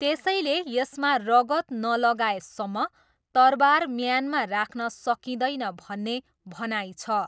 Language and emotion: Nepali, neutral